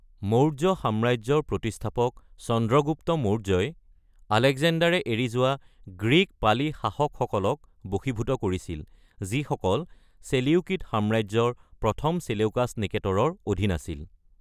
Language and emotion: Assamese, neutral